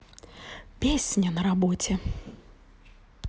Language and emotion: Russian, neutral